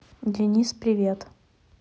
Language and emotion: Russian, neutral